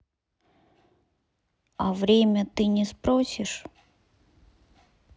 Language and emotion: Russian, sad